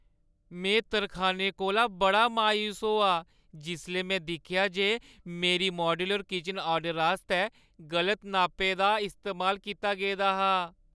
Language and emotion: Dogri, sad